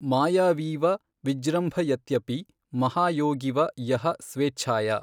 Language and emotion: Kannada, neutral